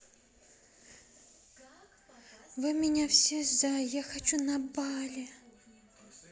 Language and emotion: Russian, sad